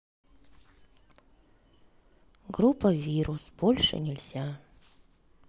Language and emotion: Russian, sad